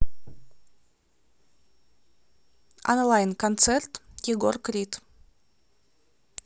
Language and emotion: Russian, neutral